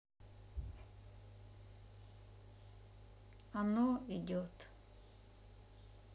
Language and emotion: Russian, sad